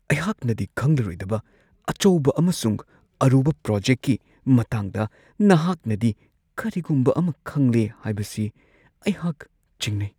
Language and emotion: Manipuri, fearful